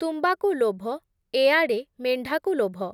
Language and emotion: Odia, neutral